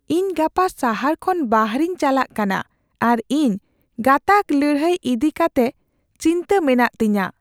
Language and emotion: Santali, fearful